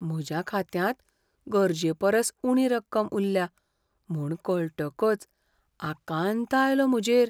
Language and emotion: Goan Konkani, fearful